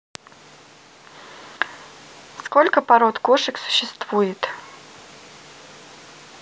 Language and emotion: Russian, neutral